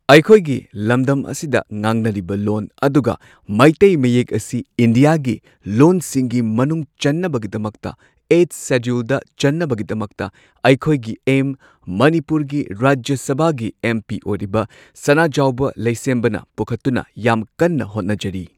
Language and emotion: Manipuri, neutral